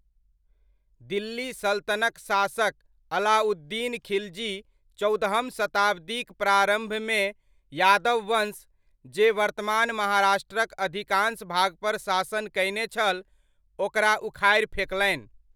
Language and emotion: Maithili, neutral